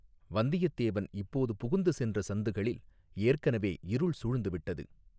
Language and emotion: Tamil, neutral